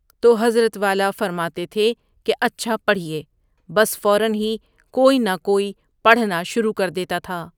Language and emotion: Urdu, neutral